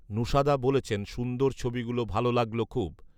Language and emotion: Bengali, neutral